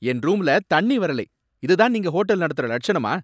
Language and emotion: Tamil, angry